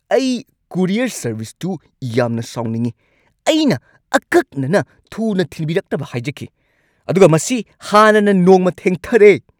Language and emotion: Manipuri, angry